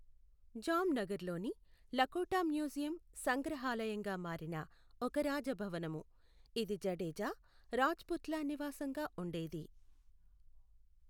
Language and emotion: Telugu, neutral